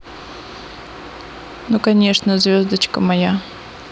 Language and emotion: Russian, neutral